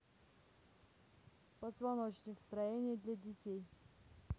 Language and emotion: Russian, neutral